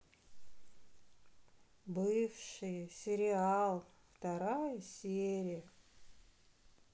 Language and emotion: Russian, sad